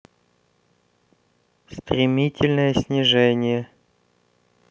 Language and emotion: Russian, neutral